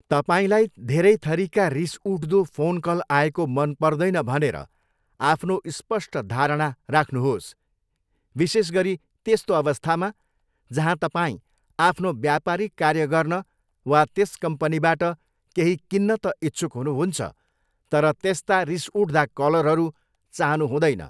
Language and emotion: Nepali, neutral